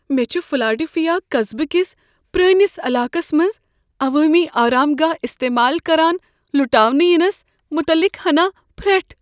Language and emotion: Kashmiri, fearful